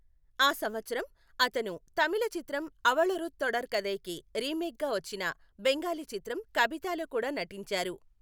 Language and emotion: Telugu, neutral